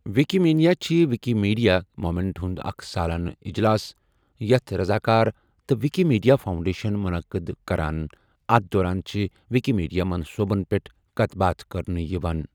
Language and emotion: Kashmiri, neutral